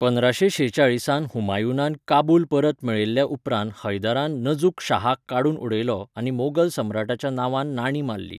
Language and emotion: Goan Konkani, neutral